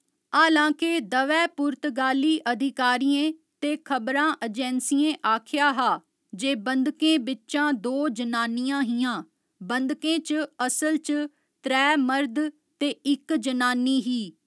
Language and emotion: Dogri, neutral